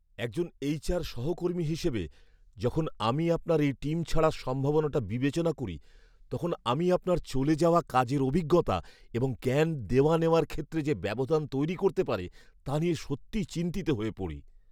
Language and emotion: Bengali, fearful